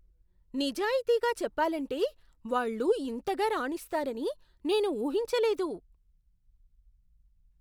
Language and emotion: Telugu, surprised